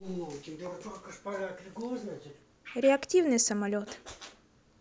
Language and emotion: Russian, neutral